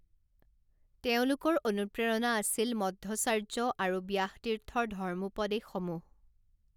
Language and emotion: Assamese, neutral